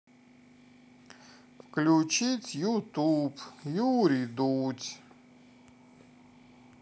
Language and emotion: Russian, sad